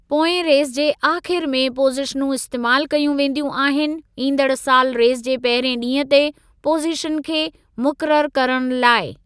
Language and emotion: Sindhi, neutral